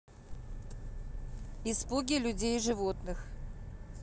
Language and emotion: Russian, neutral